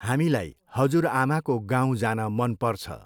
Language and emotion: Nepali, neutral